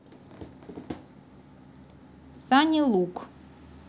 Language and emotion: Russian, neutral